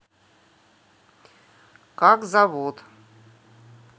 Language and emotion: Russian, neutral